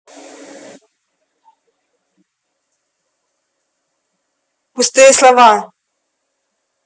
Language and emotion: Russian, angry